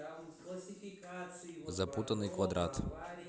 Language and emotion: Russian, neutral